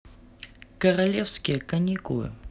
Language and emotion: Russian, neutral